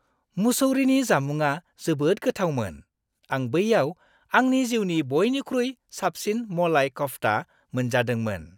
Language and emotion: Bodo, happy